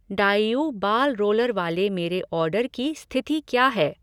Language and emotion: Hindi, neutral